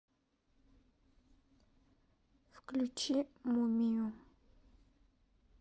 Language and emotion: Russian, sad